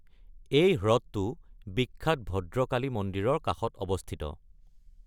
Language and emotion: Assamese, neutral